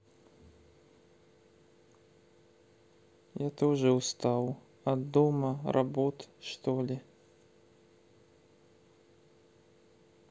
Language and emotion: Russian, sad